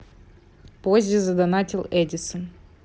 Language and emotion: Russian, neutral